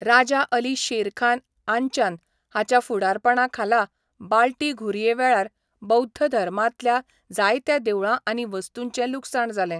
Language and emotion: Goan Konkani, neutral